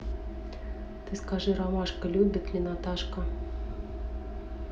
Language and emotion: Russian, neutral